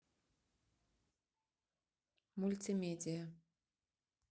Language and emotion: Russian, neutral